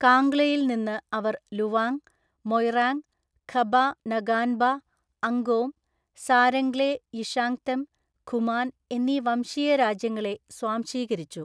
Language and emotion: Malayalam, neutral